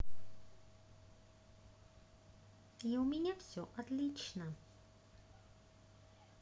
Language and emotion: Russian, positive